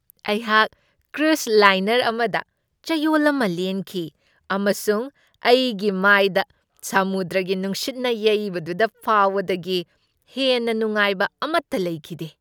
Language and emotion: Manipuri, happy